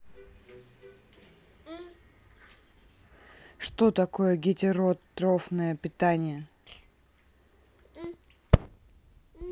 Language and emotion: Russian, neutral